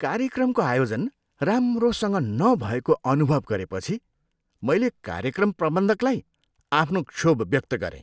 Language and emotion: Nepali, disgusted